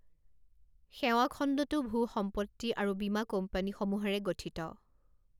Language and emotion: Assamese, neutral